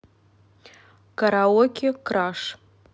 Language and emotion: Russian, neutral